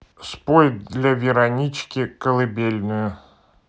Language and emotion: Russian, neutral